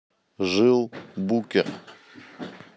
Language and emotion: Russian, neutral